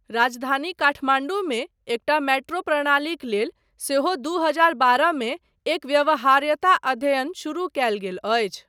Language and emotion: Maithili, neutral